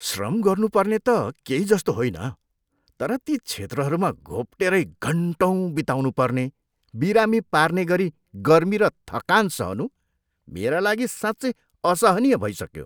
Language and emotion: Nepali, disgusted